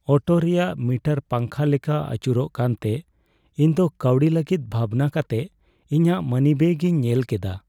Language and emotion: Santali, sad